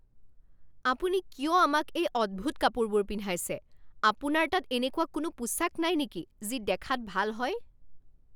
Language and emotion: Assamese, angry